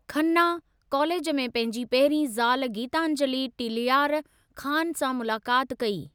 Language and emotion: Sindhi, neutral